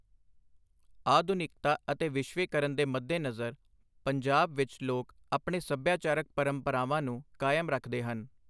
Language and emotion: Punjabi, neutral